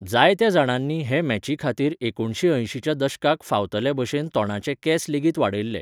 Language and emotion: Goan Konkani, neutral